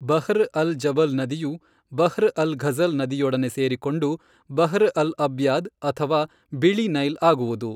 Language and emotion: Kannada, neutral